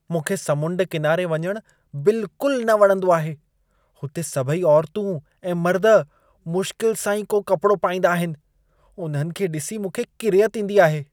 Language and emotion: Sindhi, disgusted